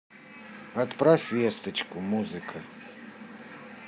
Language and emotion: Russian, neutral